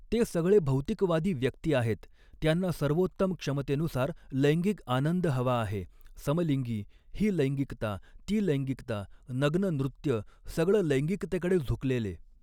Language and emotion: Marathi, neutral